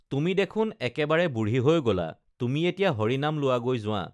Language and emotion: Assamese, neutral